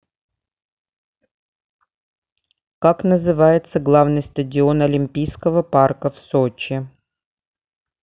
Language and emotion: Russian, neutral